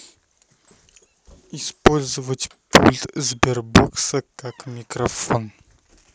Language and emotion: Russian, neutral